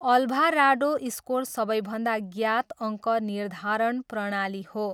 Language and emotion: Nepali, neutral